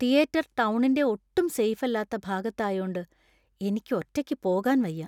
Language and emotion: Malayalam, fearful